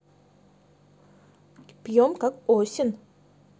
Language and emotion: Russian, neutral